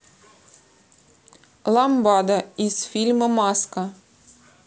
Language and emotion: Russian, neutral